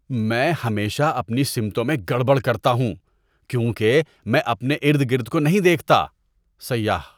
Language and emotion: Urdu, disgusted